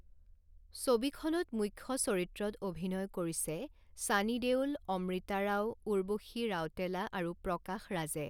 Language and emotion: Assamese, neutral